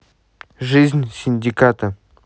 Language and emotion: Russian, neutral